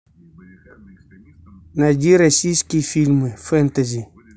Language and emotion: Russian, neutral